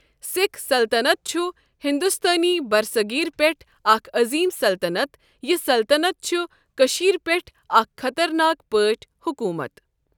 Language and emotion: Kashmiri, neutral